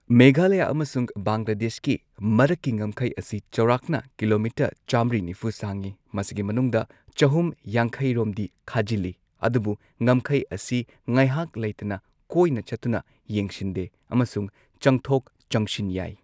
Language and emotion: Manipuri, neutral